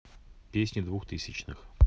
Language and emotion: Russian, neutral